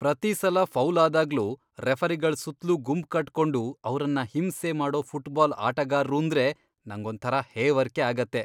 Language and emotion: Kannada, disgusted